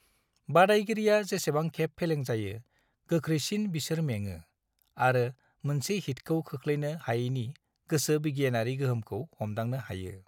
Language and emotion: Bodo, neutral